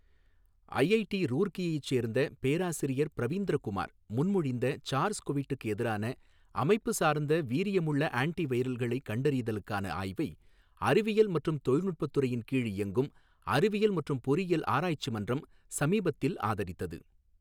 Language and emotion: Tamil, neutral